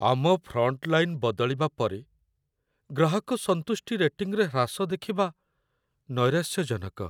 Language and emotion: Odia, sad